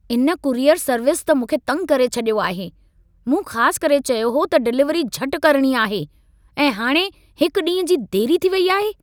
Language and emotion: Sindhi, angry